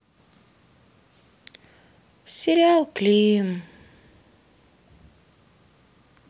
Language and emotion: Russian, sad